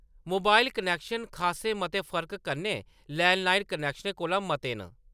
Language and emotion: Dogri, neutral